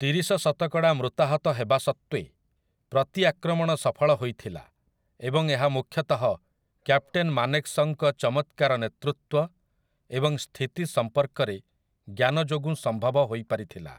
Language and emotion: Odia, neutral